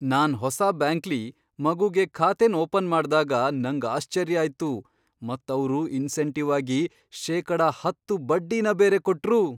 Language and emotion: Kannada, surprised